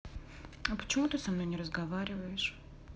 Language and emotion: Russian, sad